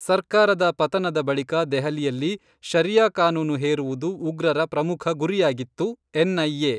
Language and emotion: Kannada, neutral